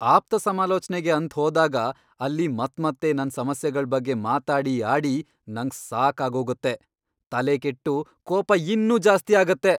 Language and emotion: Kannada, angry